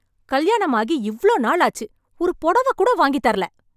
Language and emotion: Tamil, angry